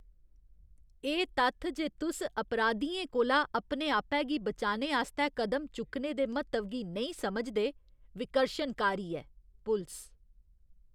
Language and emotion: Dogri, disgusted